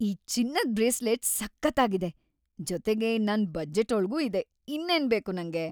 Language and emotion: Kannada, happy